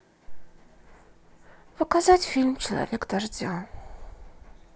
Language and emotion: Russian, sad